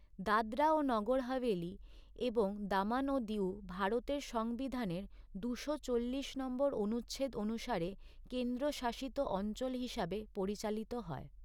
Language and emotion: Bengali, neutral